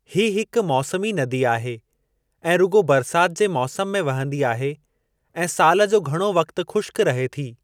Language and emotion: Sindhi, neutral